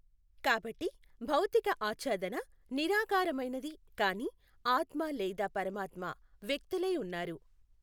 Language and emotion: Telugu, neutral